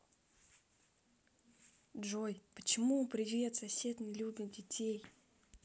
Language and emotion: Russian, neutral